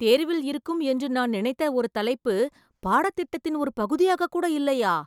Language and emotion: Tamil, surprised